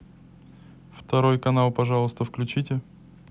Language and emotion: Russian, neutral